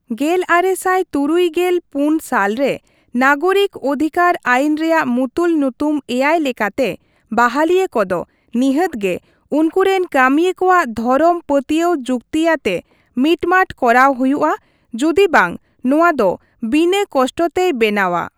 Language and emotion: Santali, neutral